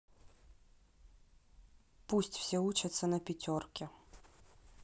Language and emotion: Russian, neutral